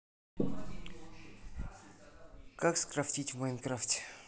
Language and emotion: Russian, neutral